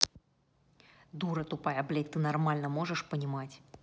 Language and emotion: Russian, angry